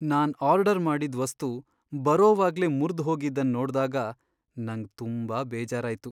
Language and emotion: Kannada, sad